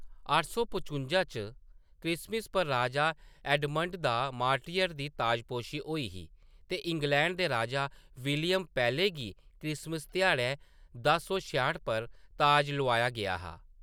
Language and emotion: Dogri, neutral